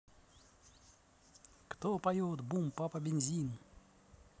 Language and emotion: Russian, positive